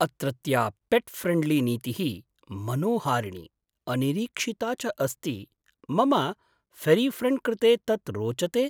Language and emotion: Sanskrit, surprised